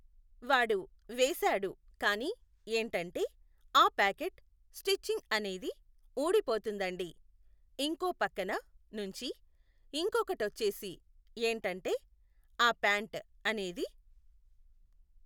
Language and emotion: Telugu, neutral